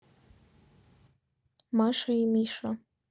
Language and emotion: Russian, neutral